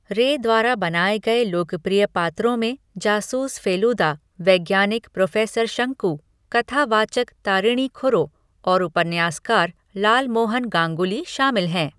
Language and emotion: Hindi, neutral